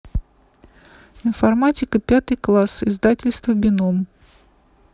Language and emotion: Russian, neutral